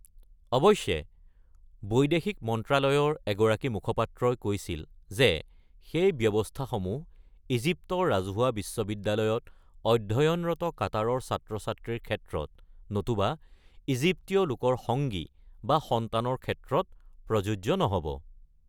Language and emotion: Assamese, neutral